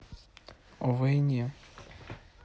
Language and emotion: Russian, neutral